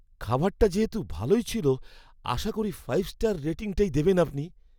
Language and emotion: Bengali, fearful